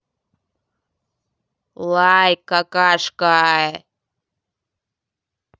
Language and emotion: Russian, angry